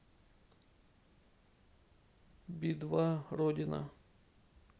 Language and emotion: Russian, neutral